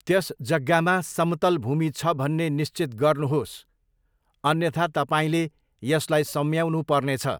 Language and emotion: Nepali, neutral